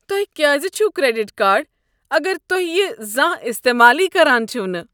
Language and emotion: Kashmiri, disgusted